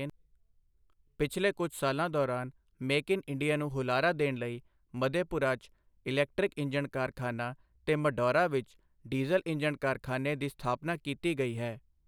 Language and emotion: Punjabi, neutral